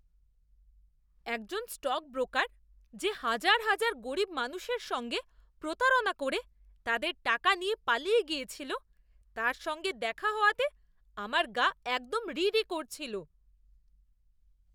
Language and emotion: Bengali, disgusted